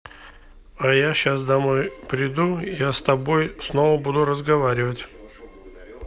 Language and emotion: Russian, neutral